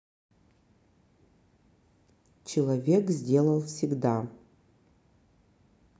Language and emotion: Russian, neutral